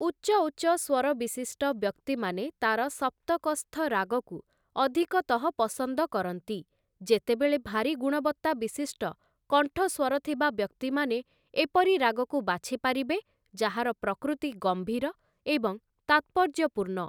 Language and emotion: Odia, neutral